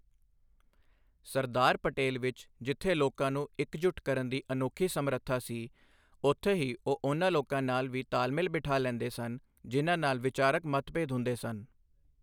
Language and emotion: Punjabi, neutral